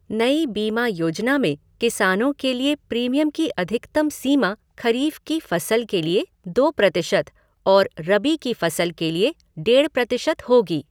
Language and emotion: Hindi, neutral